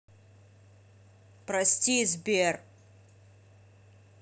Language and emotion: Russian, neutral